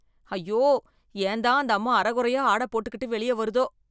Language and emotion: Tamil, disgusted